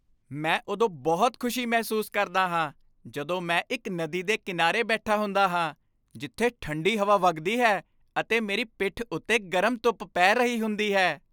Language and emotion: Punjabi, happy